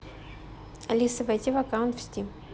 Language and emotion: Russian, neutral